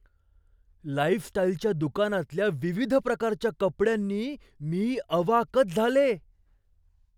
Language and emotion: Marathi, surprised